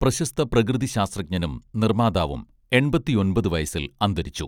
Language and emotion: Malayalam, neutral